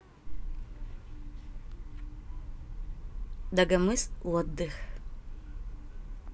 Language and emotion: Russian, neutral